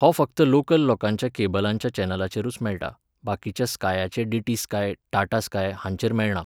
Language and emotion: Goan Konkani, neutral